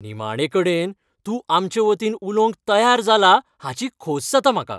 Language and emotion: Goan Konkani, happy